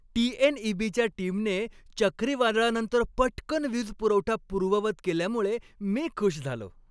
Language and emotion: Marathi, happy